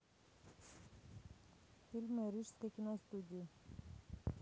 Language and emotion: Russian, neutral